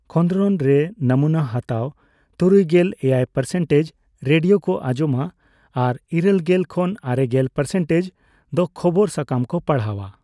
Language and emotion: Santali, neutral